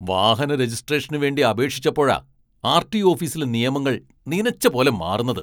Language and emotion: Malayalam, angry